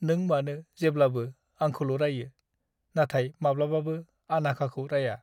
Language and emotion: Bodo, sad